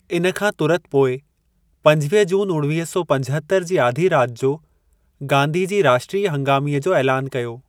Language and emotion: Sindhi, neutral